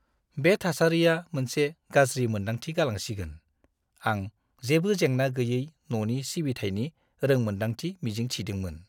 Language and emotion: Bodo, disgusted